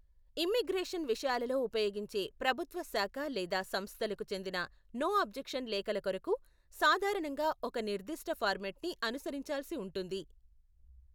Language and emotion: Telugu, neutral